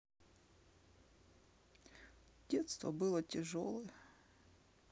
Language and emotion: Russian, sad